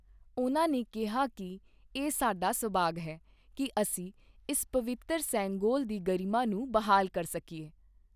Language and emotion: Punjabi, neutral